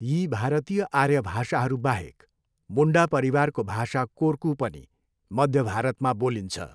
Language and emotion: Nepali, neutral